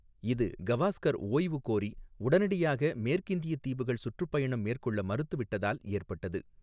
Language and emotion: Tamil, neutral